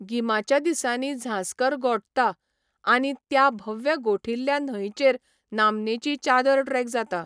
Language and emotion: Goan Konkani, neutral